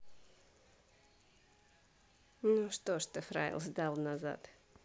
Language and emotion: Russian, neutral